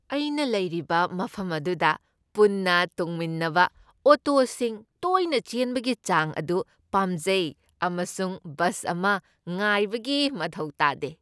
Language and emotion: Manipuri, happy